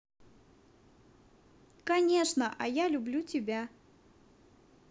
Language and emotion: Russian, positive